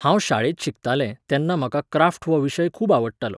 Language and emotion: Goan Konkani, neutral